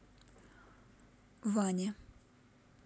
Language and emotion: Russian, neutral